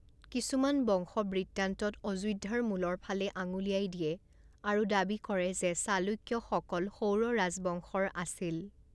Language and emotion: Assamese, neutral